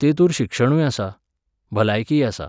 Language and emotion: Goan Konkani, neutral